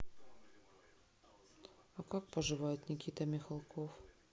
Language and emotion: Russian, sad